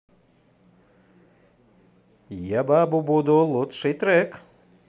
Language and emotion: Russian, positive